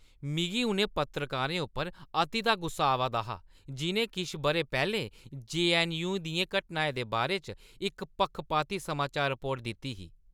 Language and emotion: Dogri, angry